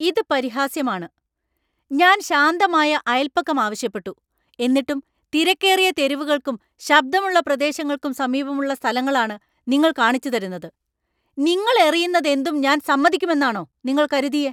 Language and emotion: Malayalam, angry